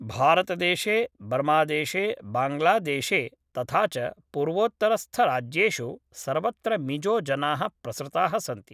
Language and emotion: Sanskrit, neutral